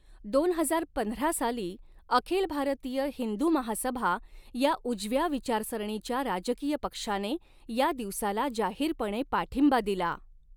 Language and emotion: Marathi, neutral